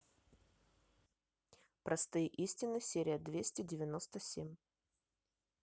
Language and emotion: Russian, neutral